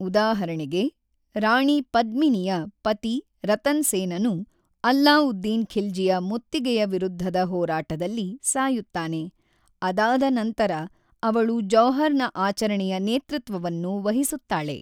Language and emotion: Kannada, neutral